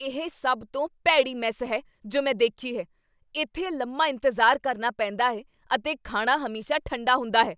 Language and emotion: Punjabi, angry